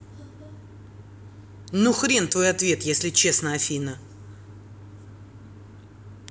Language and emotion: Russian, angry